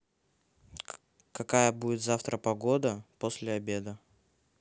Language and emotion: Russian, neutral